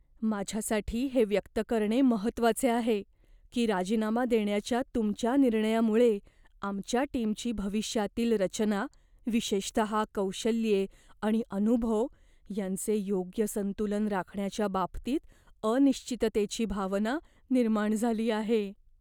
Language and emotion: Marathi, fearful